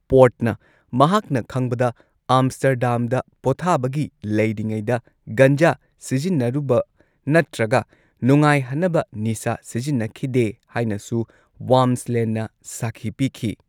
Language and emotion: Manipuri, neutral